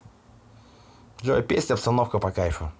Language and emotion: Russian, positive